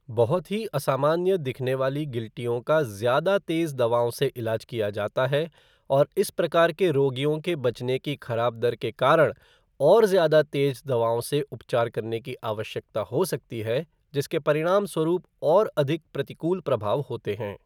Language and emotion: Hindi, neutral